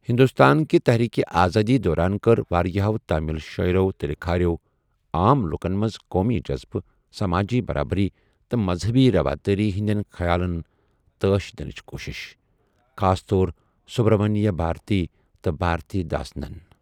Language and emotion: Kashmiri, neutral